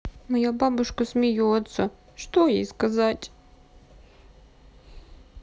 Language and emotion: Russian, sad